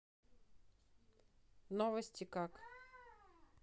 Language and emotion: Russian, neutral